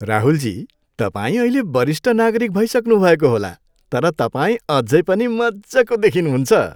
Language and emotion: Nepali, happy